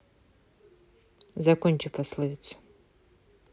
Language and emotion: Russian, neutral